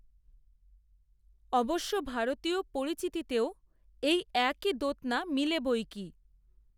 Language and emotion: Bengali, neutral